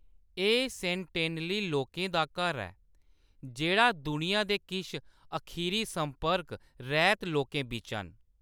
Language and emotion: Dogri, neutral